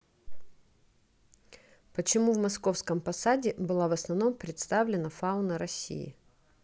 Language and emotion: Russian, neutral